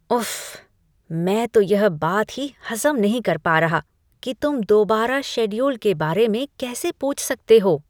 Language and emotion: Hindi, disgusted